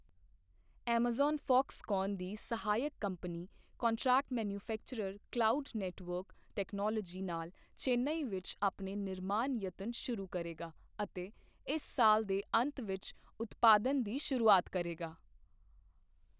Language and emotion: Punjabi, neutral